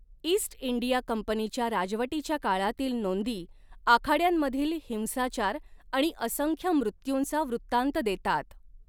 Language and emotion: Marathi, neutral